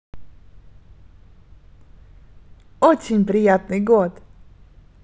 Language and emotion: Russian, positive